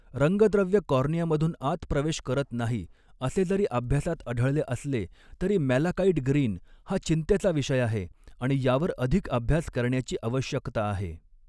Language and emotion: Marathi, neutral